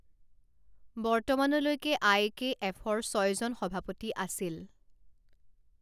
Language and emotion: Assamese, neutral